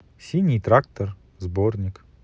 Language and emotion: Russian, neutral